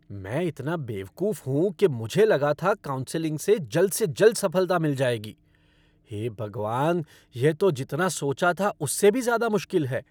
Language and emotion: Hindi, angry